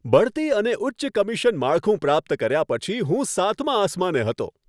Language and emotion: Gujarati, happy